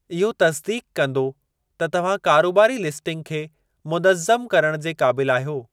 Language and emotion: Sindhi, neutral